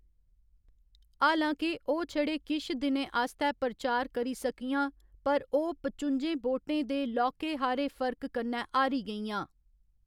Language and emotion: Dogri, neutral